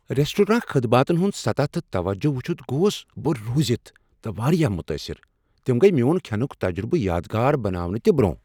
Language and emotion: Kashmiri, surprised